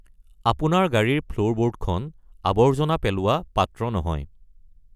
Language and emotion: Assamese, neutral